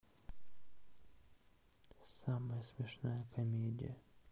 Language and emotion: Russian, sad